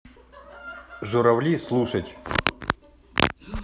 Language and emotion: Russian, neutral